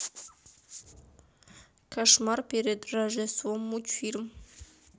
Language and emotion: Russian, neutral